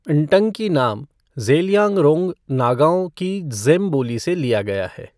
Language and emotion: Hindi, neutral